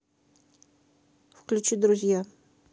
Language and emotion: Russian, neutral